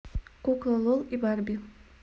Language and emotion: Russian, neutral